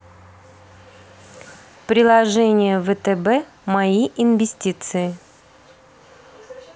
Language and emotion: Russian, neutral